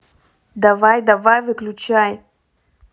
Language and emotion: Russian, angry